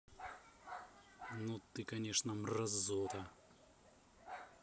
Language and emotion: Russian, angry